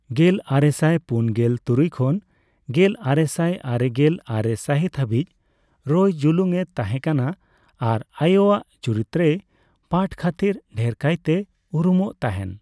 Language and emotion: Santali, neutral